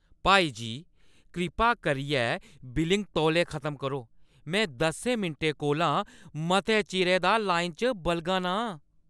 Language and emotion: Dogri, angry